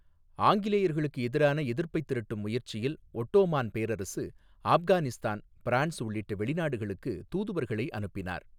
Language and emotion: Tamil, neutral